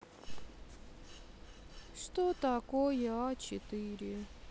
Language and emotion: Russian, sad